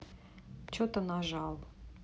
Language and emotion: Russian, neutral